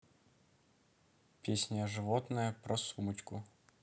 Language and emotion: Russian, neutral